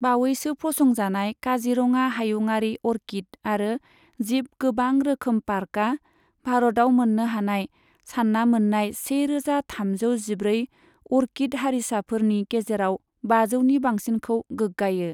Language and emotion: Bodo, neutral